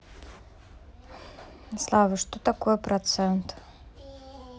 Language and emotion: Russian, neutral